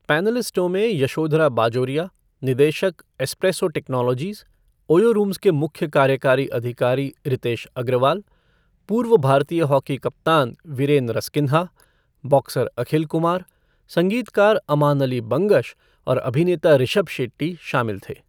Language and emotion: Hindi, neutral